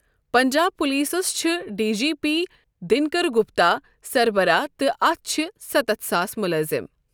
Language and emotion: Kashmiri, neutral